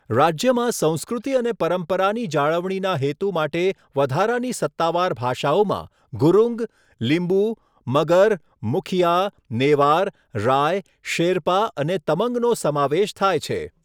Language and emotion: Gujarati, neutral